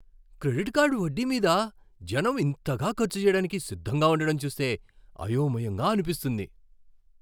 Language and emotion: Telugu, surprised